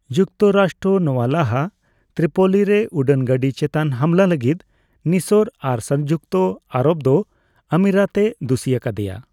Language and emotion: Santali, neutral